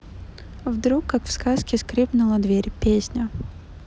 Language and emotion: Russian, neutral